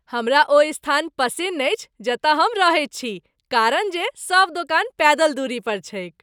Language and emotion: Maithili, happy